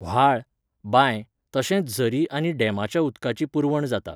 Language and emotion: Goan Konkani, neutral